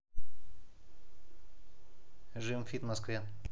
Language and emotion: Russian, neutral